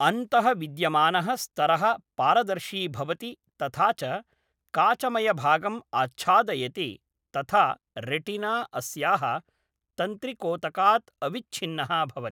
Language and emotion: Sanskrit, neutral